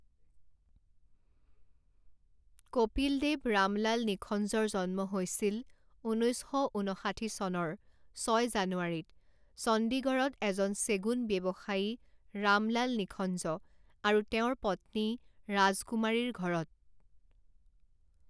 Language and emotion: Assamese, neutral